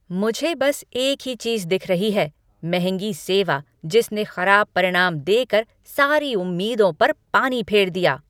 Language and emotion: Hindi, angry